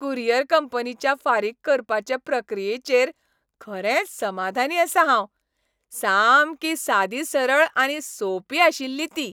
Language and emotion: Goan Konkani, happy